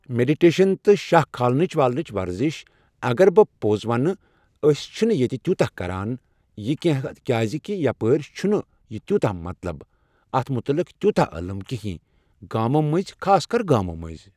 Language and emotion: Kashmiri, neutral